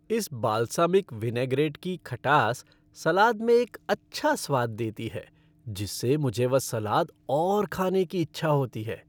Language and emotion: Hindi, happy